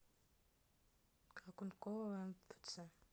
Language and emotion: Russian, neutral